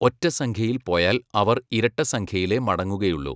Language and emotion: Malayalam, neutral